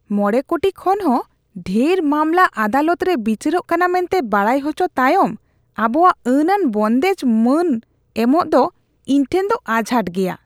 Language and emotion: Santali, disgusted